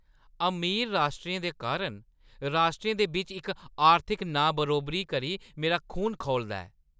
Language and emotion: Dogri, angry